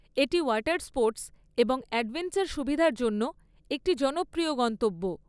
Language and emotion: Bengali, neutral